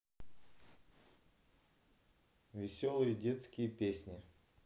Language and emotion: Russian, neutral